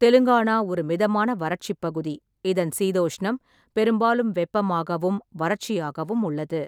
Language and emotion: Tamil, neutral